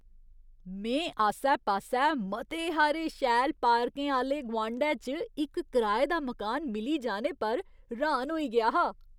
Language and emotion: Dogri, surprised